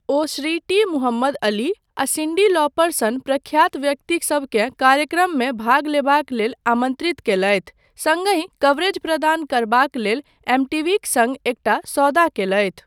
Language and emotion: Maithili, neutral